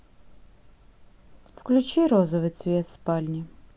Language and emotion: Russian, sad